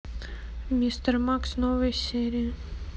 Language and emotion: Russian, neutral